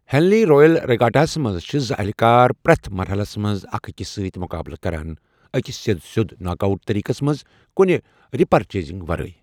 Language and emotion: Kashmiri, neutral